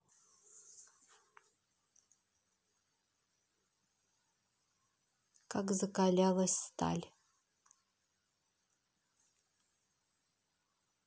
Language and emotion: Russian, neutral